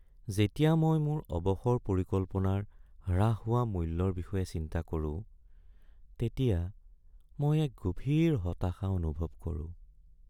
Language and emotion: Assamese, sad